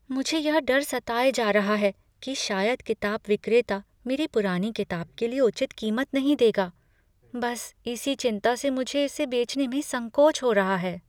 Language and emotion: Hindi, fearful